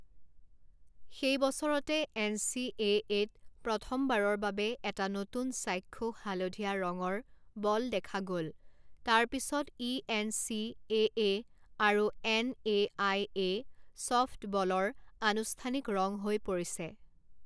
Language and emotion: Assamese, neutral